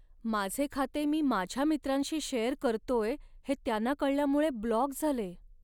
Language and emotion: Marathi, sad